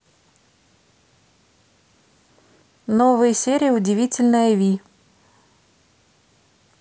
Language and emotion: Russian, neutral